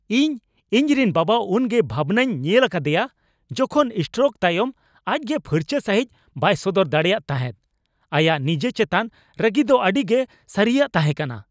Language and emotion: Santali, angry